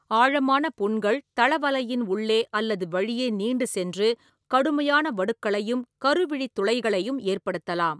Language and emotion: Tamil, neutral